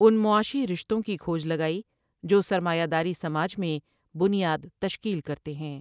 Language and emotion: Urdu, neutral